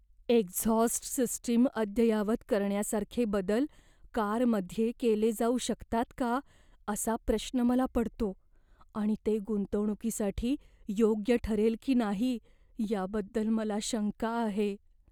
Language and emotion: Marathi, fearful